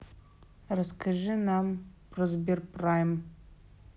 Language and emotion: Russian, neutral